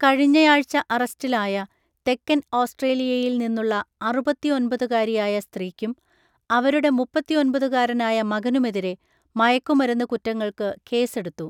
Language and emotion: Malayalam, neutral